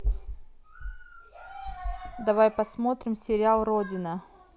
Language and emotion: Russian, neutral